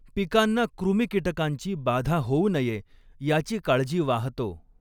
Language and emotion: Marathi, neutral